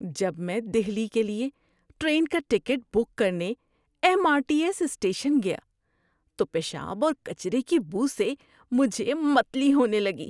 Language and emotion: Urdu, disgusted